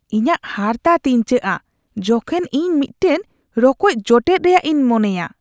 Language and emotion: Santali, disgusted